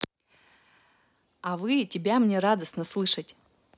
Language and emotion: Russian, positive